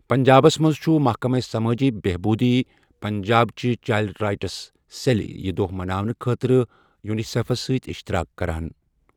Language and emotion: Kashmiri, neutral